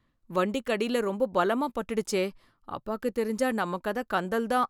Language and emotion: Tamil, fearful